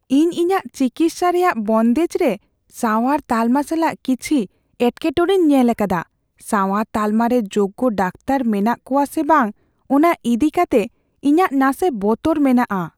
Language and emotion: Santali, fearful